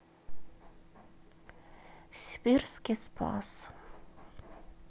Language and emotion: Russian, sad